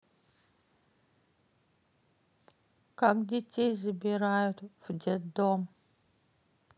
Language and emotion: Russian, sad